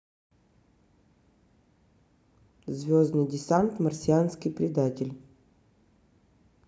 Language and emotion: Russian, neutral